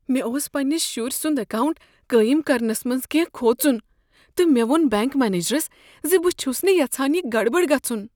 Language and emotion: Kashmiri, fearful